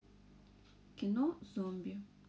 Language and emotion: Russian, neutral